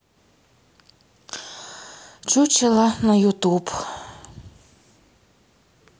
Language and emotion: Russian, sad